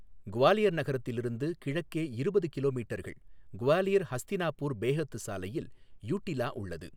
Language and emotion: Tamil, neutral